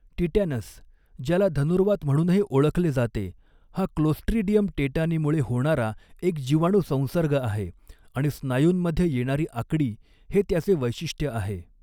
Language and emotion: Marathi, neutral